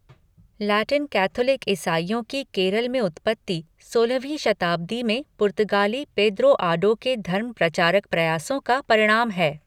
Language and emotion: Hindi, neutral